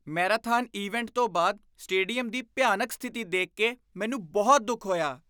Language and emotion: Punjabi, disgusted